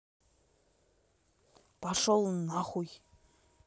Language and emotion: Russian, angry